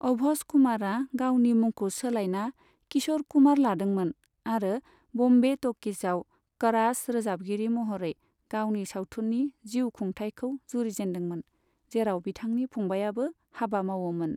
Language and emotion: Bodo, neutral